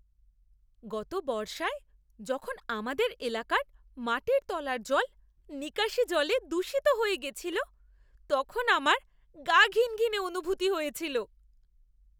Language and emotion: Bengali, disgusted